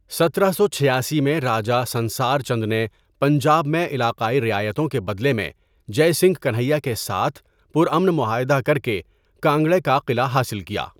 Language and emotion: Urdu, neutral